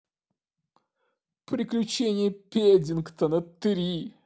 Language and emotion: Russian, sad